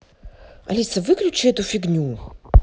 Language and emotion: Russian, angry